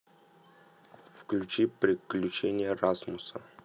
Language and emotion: Russian, neutral